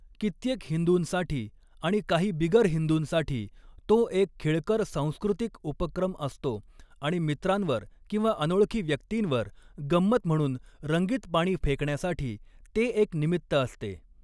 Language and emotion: Marathi, neutral